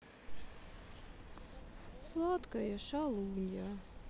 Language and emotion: Russian, sad